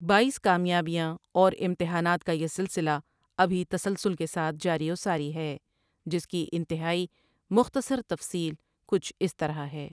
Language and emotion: Urdu, neutral